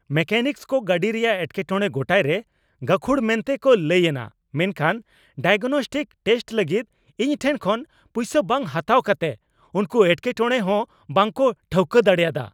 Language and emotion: Santali, angry